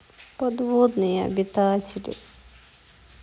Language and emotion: Russian, sad